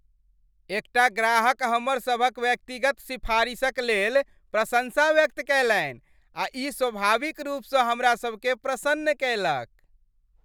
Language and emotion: Maithili, happy